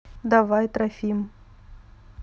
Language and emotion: Russian, neutral